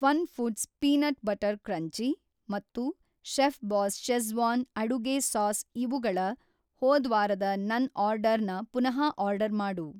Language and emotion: Kannada, neutral